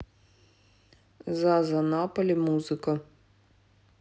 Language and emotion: Russian, neutral